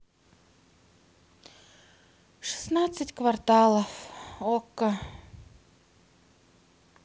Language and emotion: Russian, sad